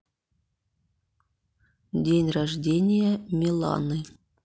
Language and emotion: Russian, neutral